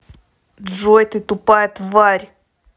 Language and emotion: Russian, angry